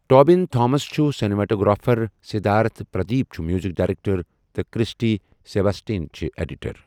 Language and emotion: Kashmiri, neutral